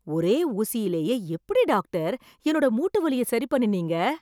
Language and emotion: Tamil, surprised